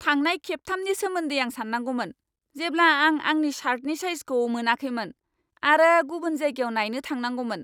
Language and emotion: Bodo, angry